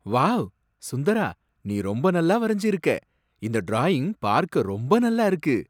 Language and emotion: Tamil, surprised